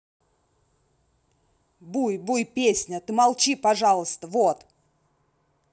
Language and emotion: Russian, angry